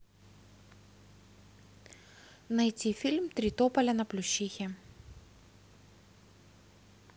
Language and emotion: Russian, neutral